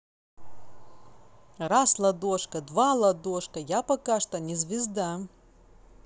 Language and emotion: Russian, positive